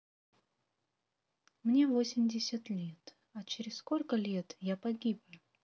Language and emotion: Russian, neutral